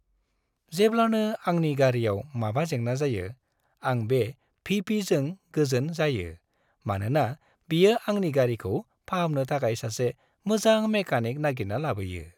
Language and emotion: Bodo, happy